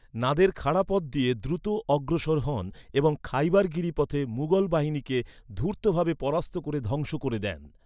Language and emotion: Bengali, neutral